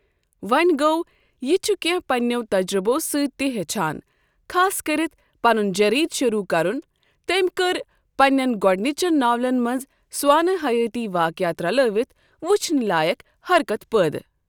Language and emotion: Kashmiri, neutral